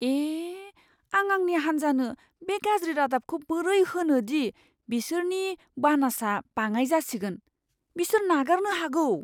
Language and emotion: Bodo, fearful